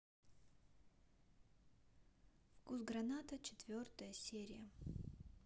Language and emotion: Russian, neutral